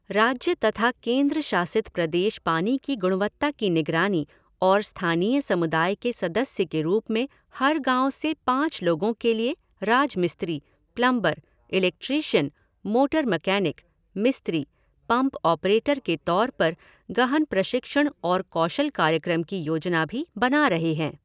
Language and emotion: Hindi, neutral